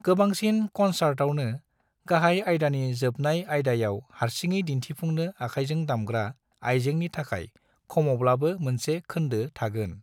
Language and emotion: Bodo, neutral